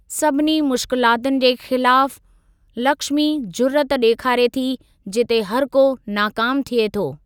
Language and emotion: Sindhi, neutral